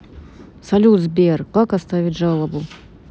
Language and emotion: Russian, neutral